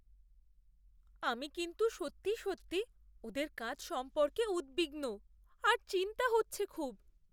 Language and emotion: Bengali, fearful